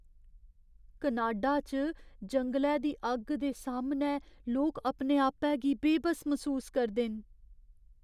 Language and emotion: Dogri, fearful